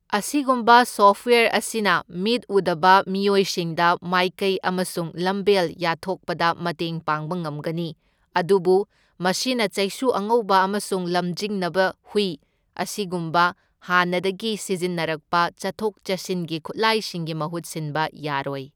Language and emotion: Manipuri, neutral